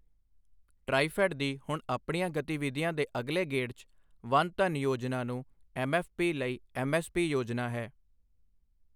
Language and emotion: Punjabi, neutral